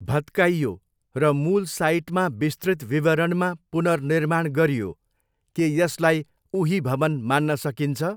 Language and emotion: Nepali, neutral